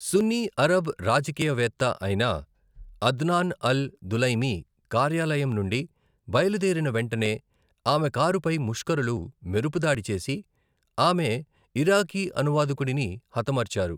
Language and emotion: Telugu, neutral